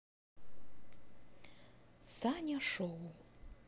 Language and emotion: Russian, positive